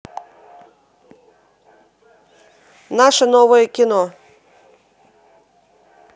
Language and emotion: Russian, neutral